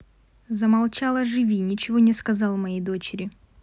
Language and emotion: Russian, neutral